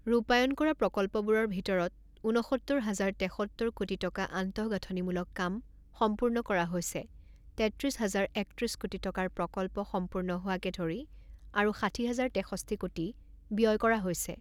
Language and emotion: Assamese, neutral